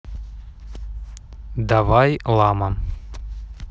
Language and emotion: Russian, neutral